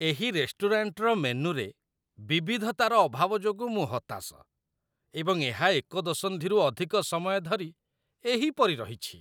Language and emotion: Odia, disgusted